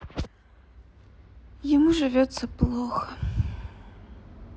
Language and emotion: Russian, sad